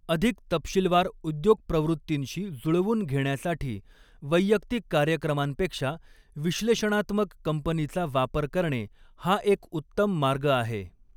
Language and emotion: Marathi, neutral